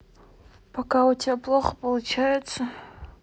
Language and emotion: Russian, neutral